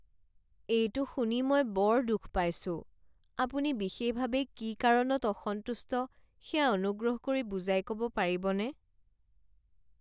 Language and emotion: Assamese, sad